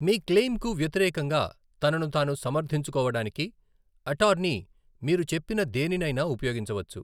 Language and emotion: Telugu, neutral